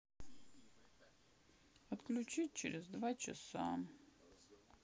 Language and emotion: Russian, sad